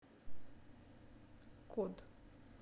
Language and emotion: Russian, neutral